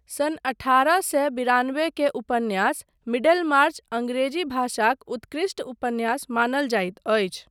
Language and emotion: Maithili, neutral